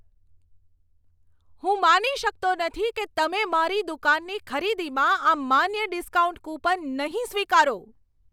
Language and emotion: Gujarati, angry